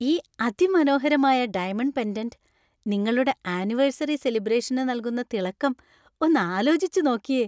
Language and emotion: Malayalam, happy